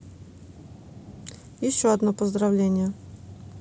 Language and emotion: Russian, neutral